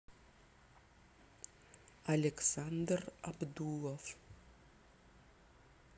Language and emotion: Russian, neutral